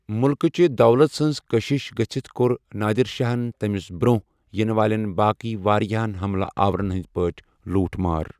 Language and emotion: Kashmiri, neutral